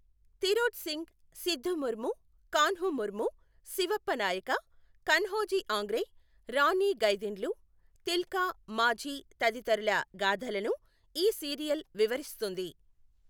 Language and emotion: Telugu, neutral